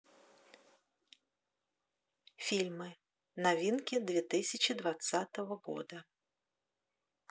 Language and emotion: Russian, neutral